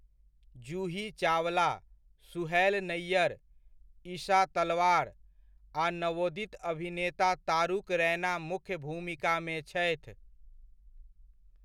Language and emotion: Maithili, neutral